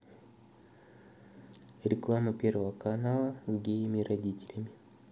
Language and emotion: Russian, neutral